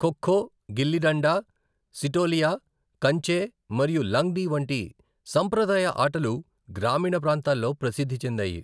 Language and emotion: Telugu, neutral